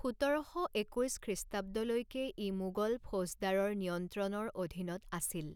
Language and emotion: Assamese, neutral